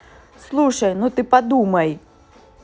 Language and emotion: Russian, neutral